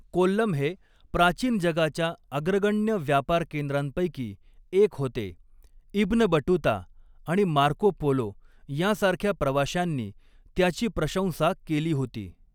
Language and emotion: Marathi, neutral